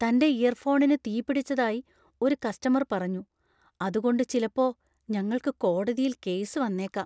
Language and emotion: Malayalam, fearful